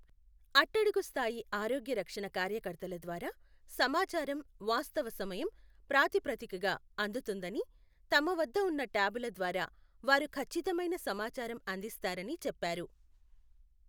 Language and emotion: Telugu, neutral